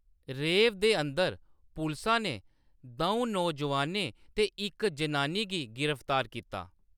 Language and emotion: Dogri, neutral